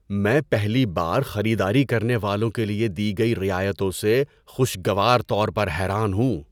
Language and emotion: Urdu, surprised